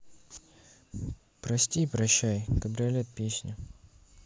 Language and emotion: Russian, sad